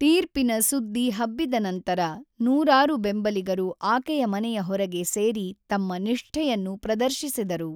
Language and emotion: Kannada, neutral